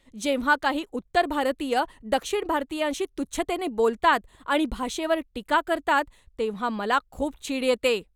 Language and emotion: Marathi, angry